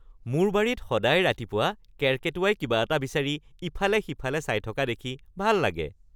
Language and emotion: Assamese, happy